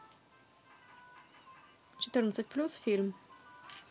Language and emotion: Russian, neutral